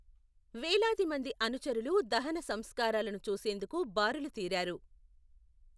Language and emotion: Telugu, neutral